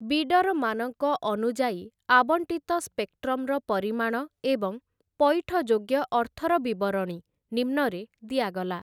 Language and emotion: Odia, neutral